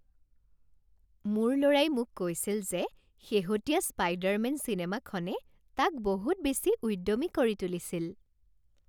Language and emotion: Assamese, happy